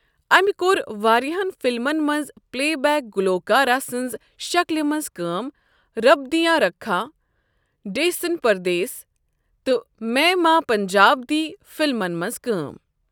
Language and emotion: Kashmiri, neutral